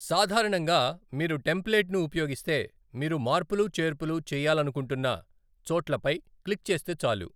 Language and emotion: Telugu, neutral